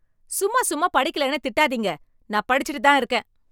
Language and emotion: Tamil, angry